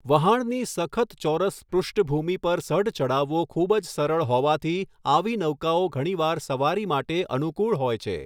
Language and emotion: Gujarati, neutral